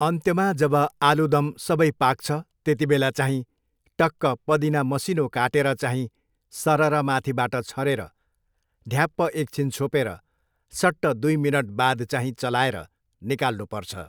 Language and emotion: Nepali, neutral